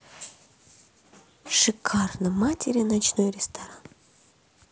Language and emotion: Russian, positive